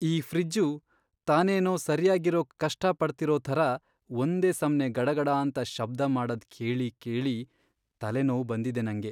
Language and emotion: Kannada, sad